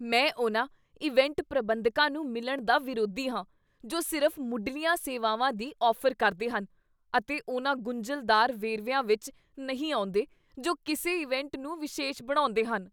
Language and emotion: Punjabi, disgusted